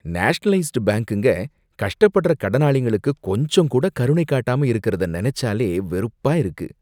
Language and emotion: Tamil, disgusted